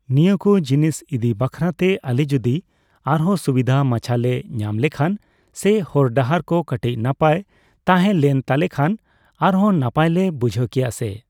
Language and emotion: Santali, neutral